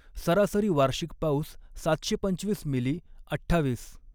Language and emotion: Marathi, neutral